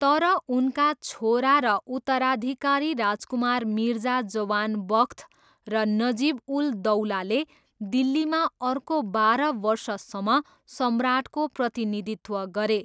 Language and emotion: Nepali, neutral